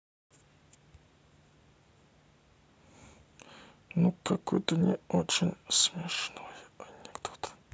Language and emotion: Russian, sad